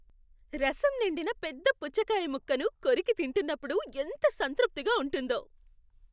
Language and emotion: Telugu, happy